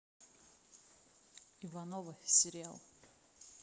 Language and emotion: Russian, neutral